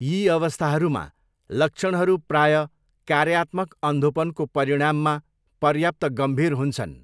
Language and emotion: Nepali, neutral